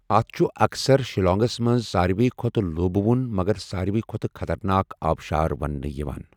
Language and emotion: Kashmiri, neutral